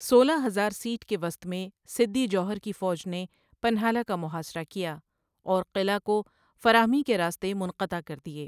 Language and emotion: Urdu, neutral